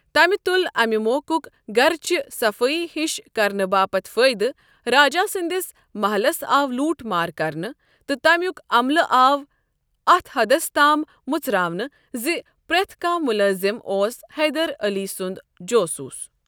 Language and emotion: Kashmiri, neutral